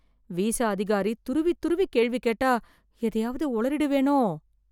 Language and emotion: Tamil, fearful